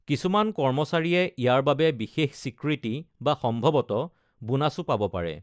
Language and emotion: Assamese, neutral